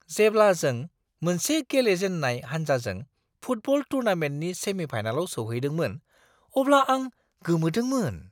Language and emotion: Bodo, surprised